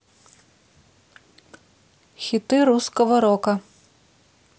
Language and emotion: Russian, neutral